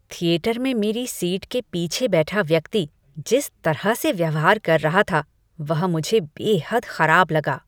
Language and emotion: Hindi, disgusted